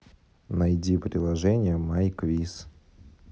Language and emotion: Russian, neutral